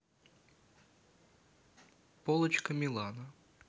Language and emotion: Russian, neutral